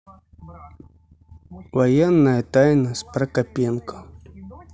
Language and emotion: Russian, neutral